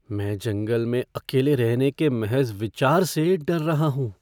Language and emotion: Hindi, fearful